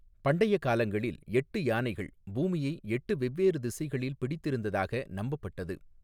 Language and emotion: Tamil, neutral